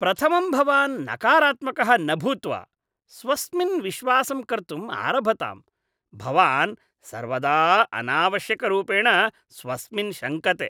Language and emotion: Sanskrit, disgusted